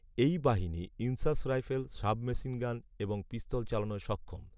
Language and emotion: Bengali, neutral